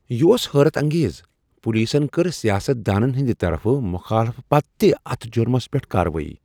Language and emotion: Kashmiri, surprised